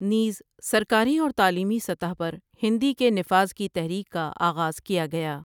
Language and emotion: Urdu, neutral